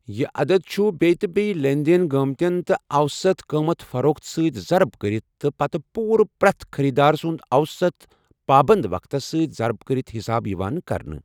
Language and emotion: Kashmiri, neutral